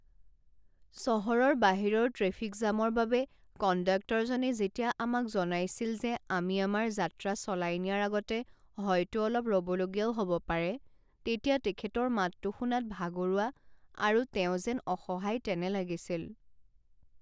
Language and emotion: Assamese, sad